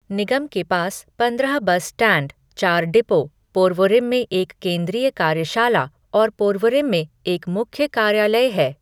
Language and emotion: Hindi, neutral